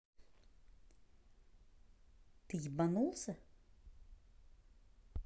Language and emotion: Russian, neutral